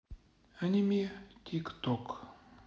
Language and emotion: Russian, sad